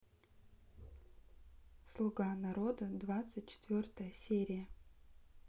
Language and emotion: Russian, neutral